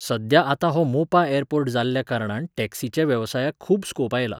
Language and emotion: Goan Konkani, neutral